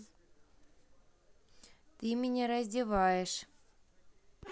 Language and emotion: Russian, neutral